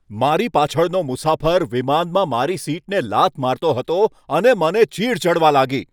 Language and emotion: Gujarati, angry